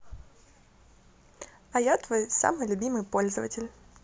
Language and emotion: Russian, positive